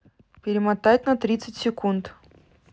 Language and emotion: Russian, neutral